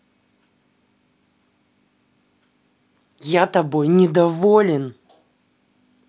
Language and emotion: Russian, angry